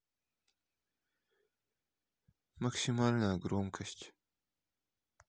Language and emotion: Russian, sad